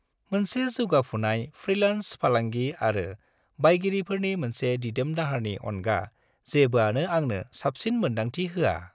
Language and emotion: Bodo, happy